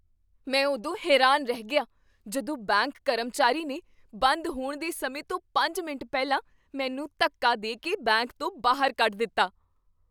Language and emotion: Punjabi, surprised